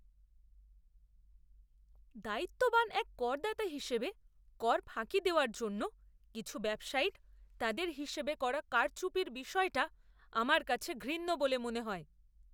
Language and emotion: Bengali, disgusted